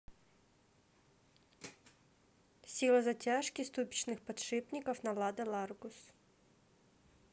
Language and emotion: Russian, neutral